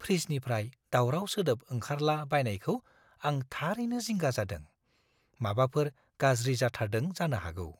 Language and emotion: Bodo, fearful